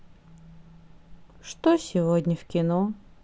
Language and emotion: Russian, sad